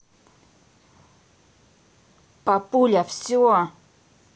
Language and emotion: Russian, angry